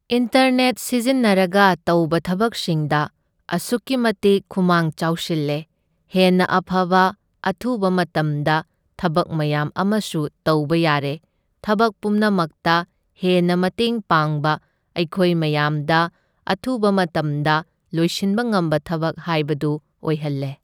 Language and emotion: Manipuri, neutral